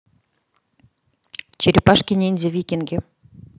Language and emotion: Russian, neutral